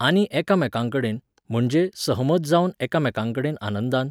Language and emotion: Goan Konkani, neutral